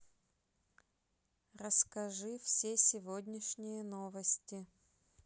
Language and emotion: Russian, neutral